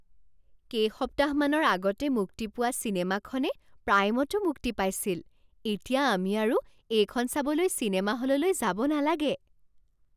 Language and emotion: Assamese, surprised